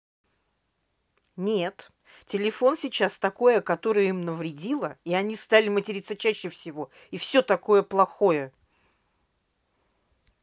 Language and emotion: Russian, angry